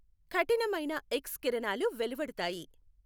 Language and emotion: Telugu, neutral